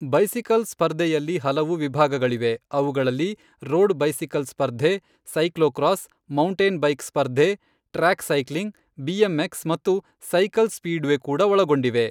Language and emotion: Kannada, neutral